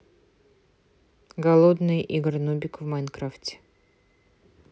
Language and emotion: Russian, neutral